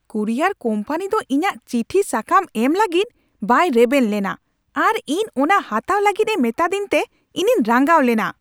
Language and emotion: Santali, angry